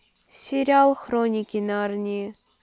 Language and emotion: Russian, neutral